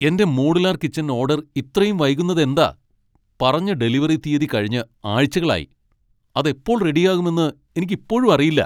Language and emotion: Malayalam, angry